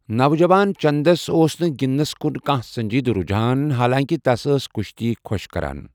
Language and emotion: Kashmiri, neutral